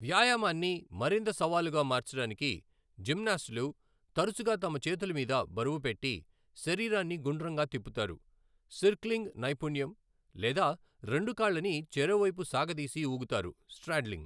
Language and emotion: Telugu, neutral